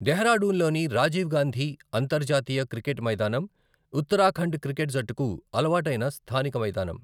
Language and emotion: Telugu, neutral